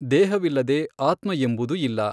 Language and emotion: Kannada, neutral